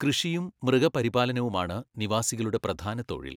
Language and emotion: Malayalam, neutral